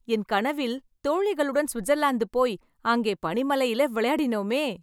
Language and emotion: Tamil, happy